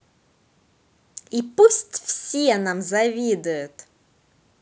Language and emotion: Russian, positive